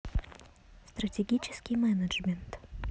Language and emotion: Russian, neutral